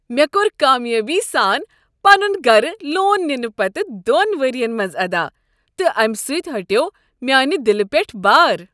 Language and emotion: Kashmiri, happy